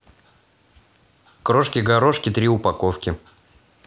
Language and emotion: Russian, positive